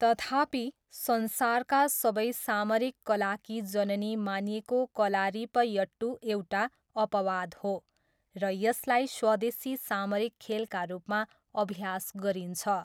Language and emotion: Nepali, neutral